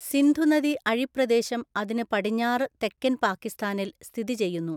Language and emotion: Malayalam, neutral